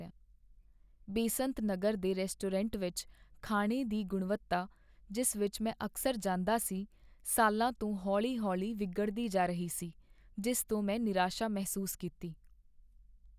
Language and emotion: Punjabi, sad